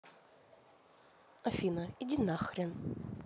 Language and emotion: Russian, neutral